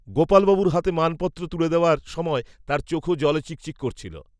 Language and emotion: Bengali, neutral